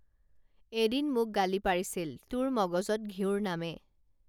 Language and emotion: Assamese, neutral